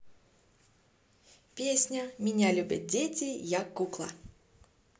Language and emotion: Russian, positive